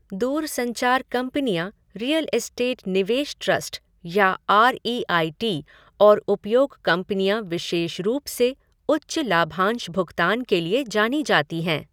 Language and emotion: Hindi, neutral